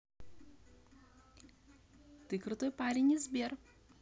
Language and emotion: Russian, positive